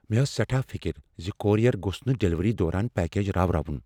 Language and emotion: Kashmiri, fearful